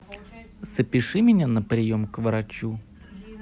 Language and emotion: Russian, neutral